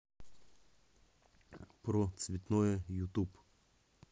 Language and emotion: Russian, neutral